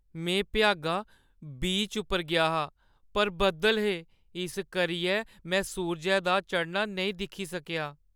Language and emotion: Dogri, sad